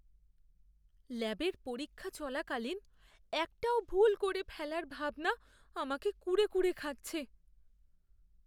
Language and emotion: Bengali, fearful